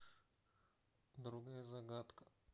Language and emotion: Russian, neutral